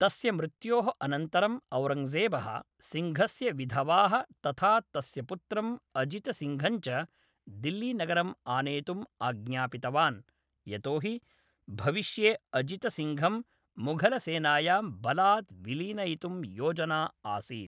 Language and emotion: Sanskrit, neutral